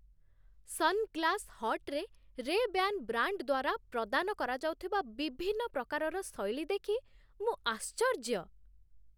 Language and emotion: Odia, surprised